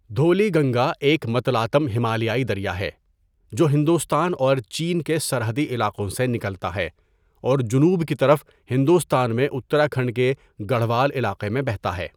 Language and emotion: Urdu, neutral